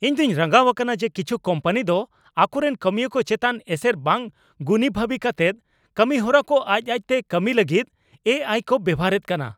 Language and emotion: Santali, angry